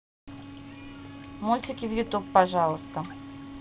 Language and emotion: Russian, neutral